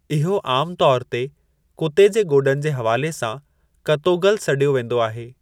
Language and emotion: Sindhi, neutral